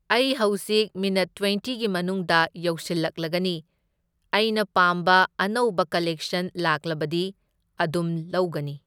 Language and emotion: Manipuri, neutral